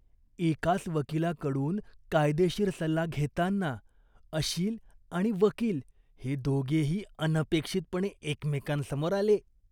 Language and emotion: Marathi, disgusted